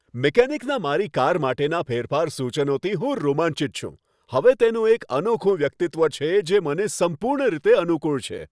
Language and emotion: Gujarati, happy